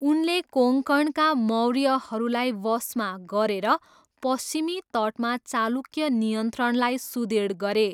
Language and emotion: Nepali, neutral